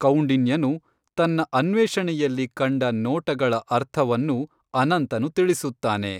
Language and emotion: Kannada, neutral